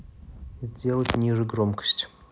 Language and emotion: Russian, neutral